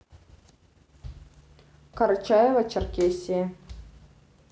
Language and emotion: Russian, neutral